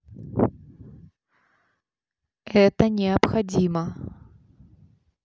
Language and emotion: Russian, neutral